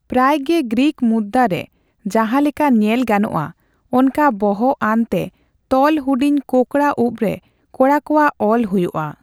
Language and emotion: Santali, neutral